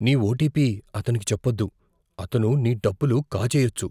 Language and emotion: Telugu, fearful